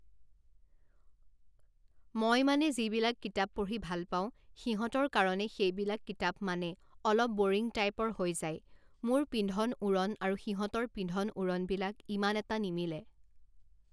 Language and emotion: Assamese, neutral